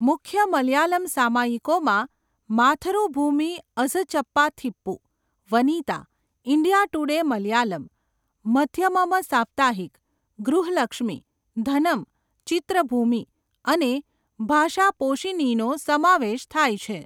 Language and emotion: Gujarati, neutral